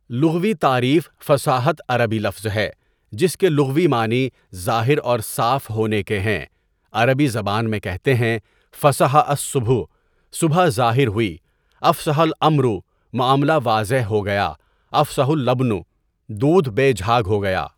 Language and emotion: Urdu, neutral